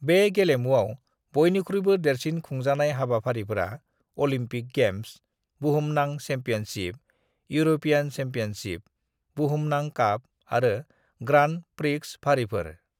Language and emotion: Bodo, neutral